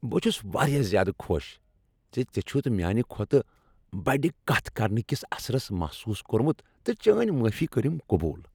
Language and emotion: Kashmiri, happy